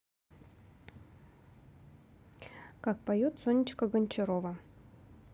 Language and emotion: Russian, neutral